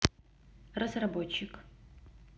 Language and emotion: Russian, neutral